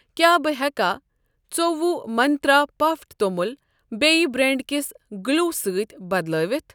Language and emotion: Kashmiri, neutral